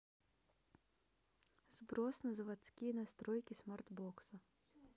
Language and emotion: Russian, neutral